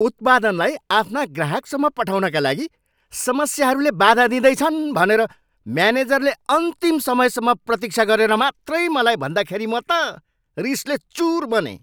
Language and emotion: Nepali, angry